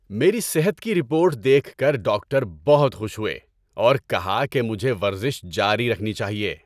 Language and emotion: Urdu, happy